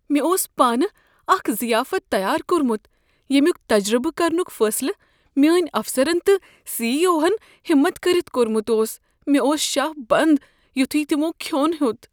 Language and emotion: Kashmiri, fearful